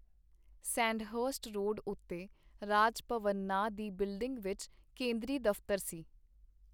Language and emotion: Punjabi, neutral